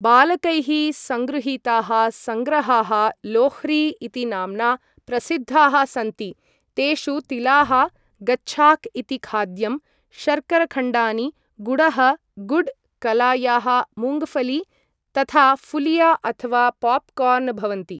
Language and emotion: Sanskrit, neutral